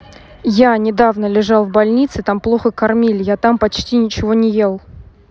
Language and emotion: Russian, neutral